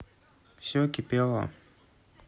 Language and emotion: Russian, neutral